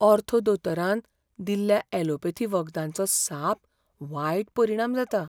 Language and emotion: Goan Konkani, fearful